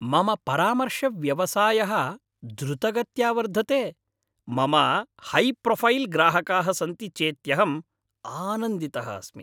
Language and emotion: Sanskrit, happy